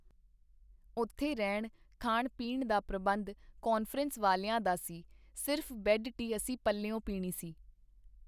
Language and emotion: Punjabi, neutral